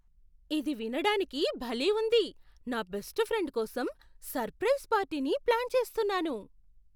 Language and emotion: Telugu, surprised